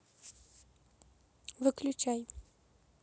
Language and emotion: Russian, neutral